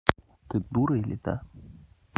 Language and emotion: Russian, angry